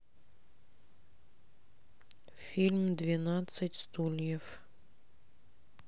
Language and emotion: Russian, sad